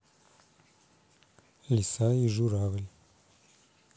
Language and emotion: Russian, neutral